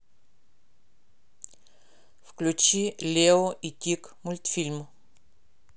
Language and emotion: Russian, neutral